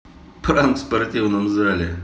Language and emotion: Russian, neutral